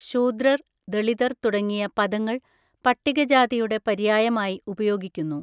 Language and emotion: Malayalam, neutral